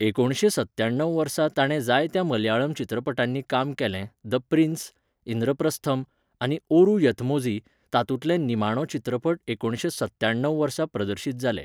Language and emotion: Goan Konkani, neutral